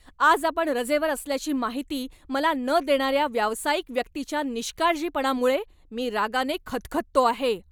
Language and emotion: Marathi, angry